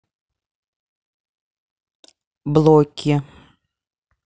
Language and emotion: Russian, neutral